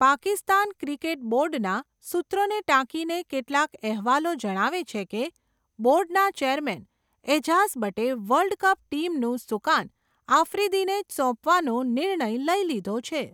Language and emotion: Gujarati, neutral